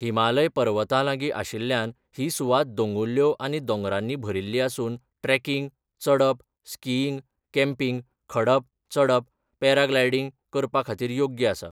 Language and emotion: Goan Konkani, neutral